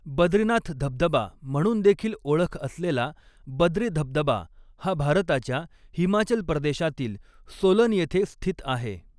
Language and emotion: Marathi, neutral